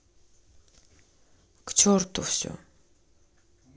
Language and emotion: Russian, angry